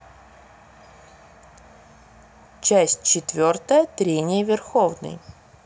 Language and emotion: Russian, neutral